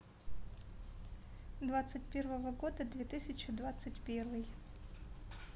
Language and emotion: Russian, neutral